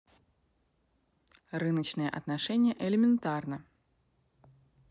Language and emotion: Russian, neutral